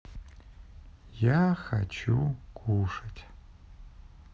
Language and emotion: Russian, neutral